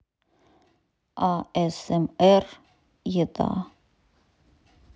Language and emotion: Russian, neutral